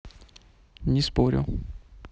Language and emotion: Russian, neutral